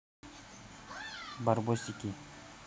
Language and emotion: Russian, neutral